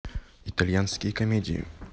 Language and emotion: Russian, neutral